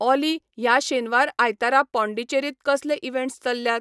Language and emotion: Goan Konkani, neutral